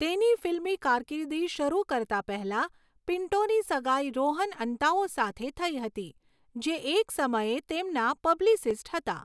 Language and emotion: Gujarati, neutral